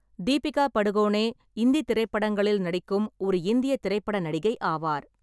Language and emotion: Tamil, neutral